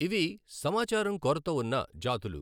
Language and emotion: Telugu, neutral